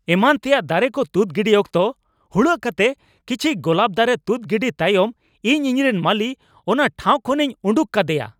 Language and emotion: Santali, angry